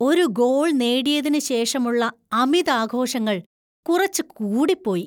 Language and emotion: Malayalam, disgusted